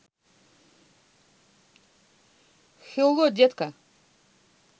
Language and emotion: Russian, positive